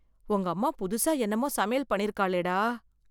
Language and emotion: Tamil, fearful